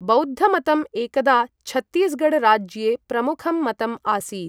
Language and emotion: Sanskrit, neutral